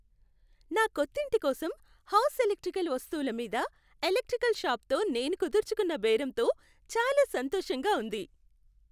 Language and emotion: Telugu, happy